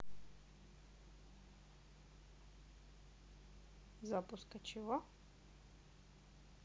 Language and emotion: Russian, neutral